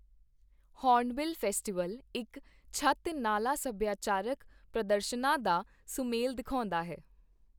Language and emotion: Punjabi, neutral